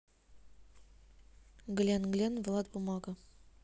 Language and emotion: Russian, neutral